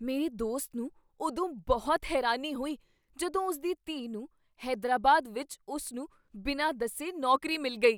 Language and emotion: Punjabi, surprised